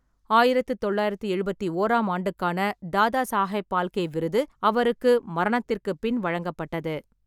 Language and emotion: Tamil, neutral